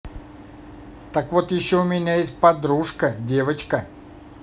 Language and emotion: Russian, positive